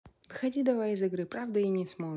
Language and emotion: Russian, neutral